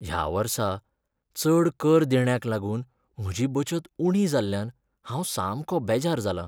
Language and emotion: Goan Konkani, sad